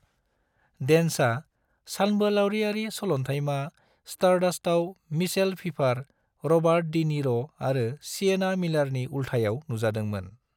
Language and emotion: Bodo, neutral